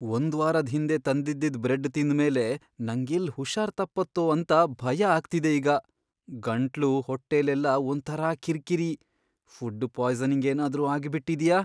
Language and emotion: Kannada, fearful